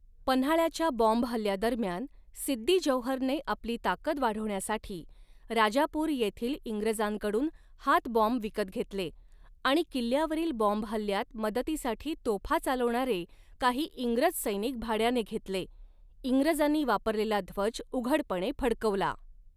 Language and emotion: Marathi, neutral